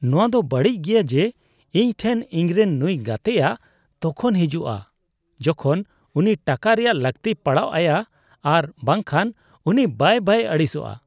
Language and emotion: Santali, disgusted